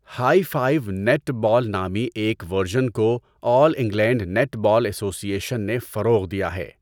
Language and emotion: Urdu, neutral